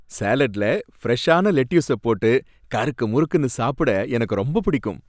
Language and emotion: Tamil, happy